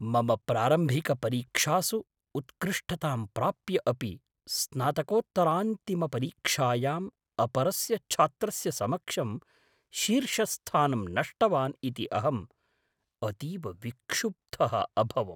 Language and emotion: Sanskrit, surprised